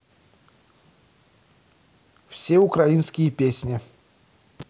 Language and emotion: Russian, neutral